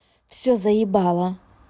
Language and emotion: Russian, angry